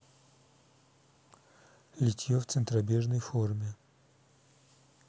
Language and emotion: Russian, neutral